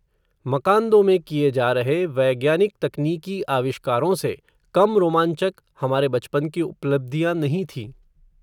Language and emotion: Hindi, neutral